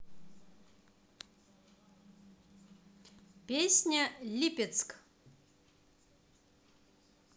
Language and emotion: Russian, positive